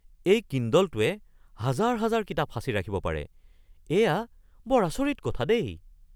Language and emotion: Assamese, surprised